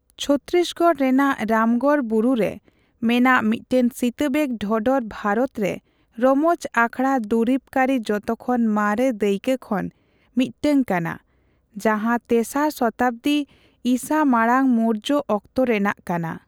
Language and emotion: Santali, neutral